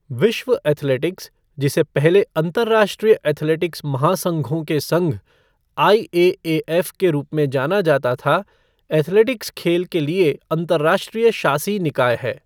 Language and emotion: Hindi, neutral